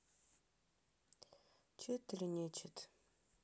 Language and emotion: Russian, sad